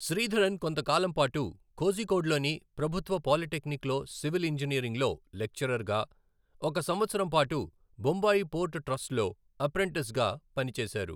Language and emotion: Telugu, neutral